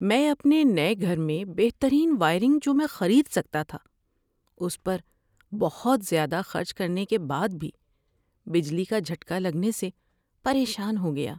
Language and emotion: Urdu, sad